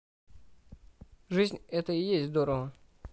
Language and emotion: Russian, neutral